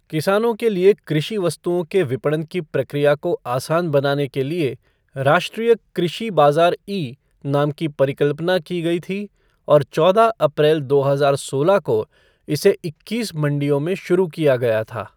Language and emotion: Hindi, neutral